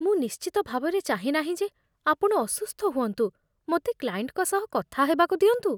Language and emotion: Odia, fearful